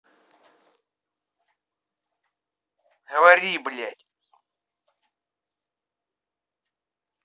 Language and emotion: Russian, angry